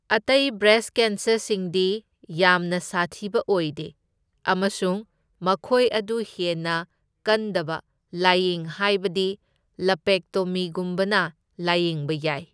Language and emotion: Manipuri, neutral